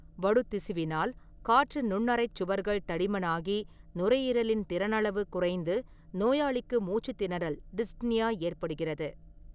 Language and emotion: Tamil, neutral